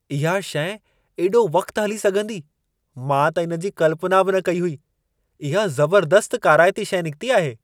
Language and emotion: Sindhi, surprised